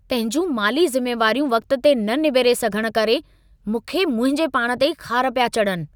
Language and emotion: Sindhi, angry